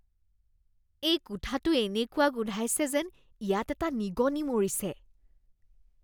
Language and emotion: Assamese, disgusted